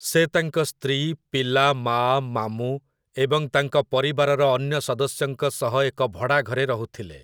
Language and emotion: Odia, neutral